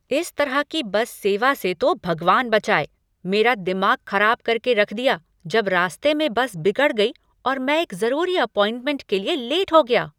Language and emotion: Hindi, angry